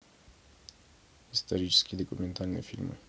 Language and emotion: Russian, neutral